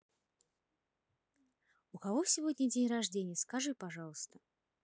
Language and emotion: Russian, neutral